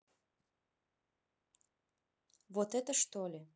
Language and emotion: Russian, neutral